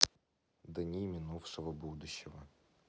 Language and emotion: Russian, neutral